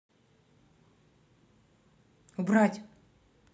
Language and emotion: Russian, angry